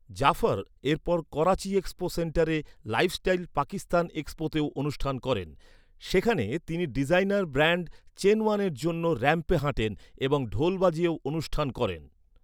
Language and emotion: Bengali, neutral